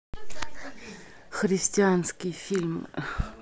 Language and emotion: Russian, neutral